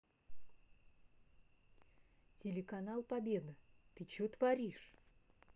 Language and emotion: Russian, neutral